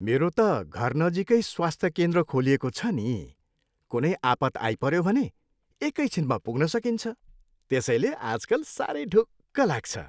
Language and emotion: Nepali, happy